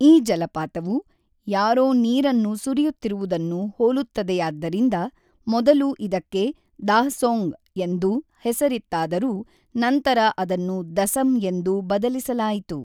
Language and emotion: Kannada, neutral